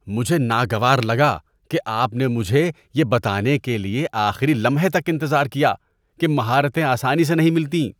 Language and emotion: Urdu, disgusted